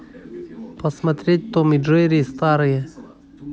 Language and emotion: Russian, neutral